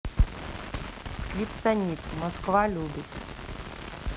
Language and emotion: Russian, neutral